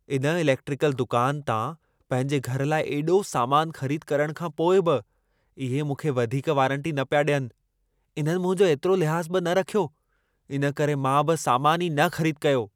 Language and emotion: Sindhi, angry